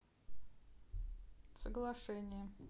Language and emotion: Russian, neutral